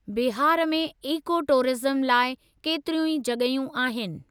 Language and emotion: Sindhi, neutral